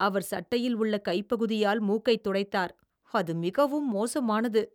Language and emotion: Tamil, disgusted